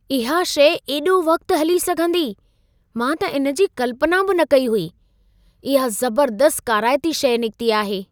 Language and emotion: Sindhi, surprised